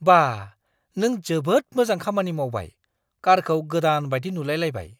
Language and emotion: Bodo, surprised